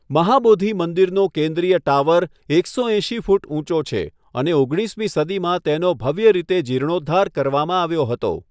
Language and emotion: Gujarati, neutral